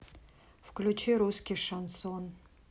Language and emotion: Russian, neutral